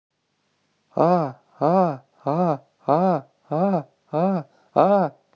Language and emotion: Russian, neutral